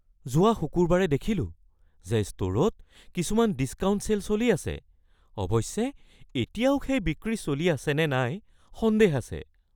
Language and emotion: Assamese, fearful